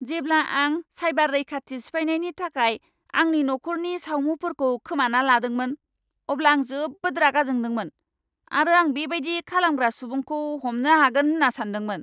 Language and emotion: Bodo, angry